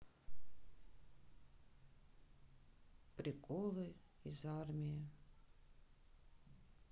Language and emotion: Russian, sad